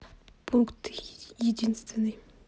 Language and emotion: Russian, neutral